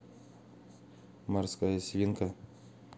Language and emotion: Russian, neutral